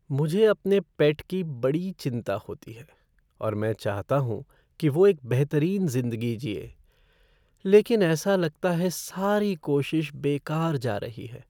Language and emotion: Hindi, sad